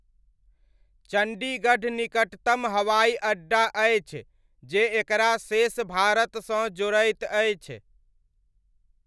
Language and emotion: Maithili, neutral